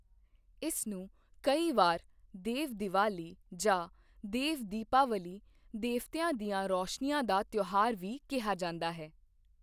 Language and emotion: Punjabi, neutral